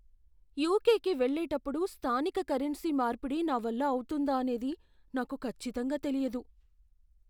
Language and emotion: Telugu, fearful